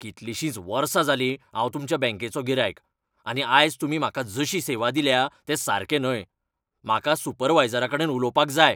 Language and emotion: Goan Konkani, angry